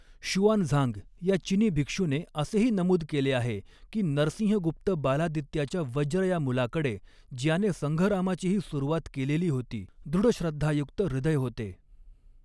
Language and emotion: Marathi, neutral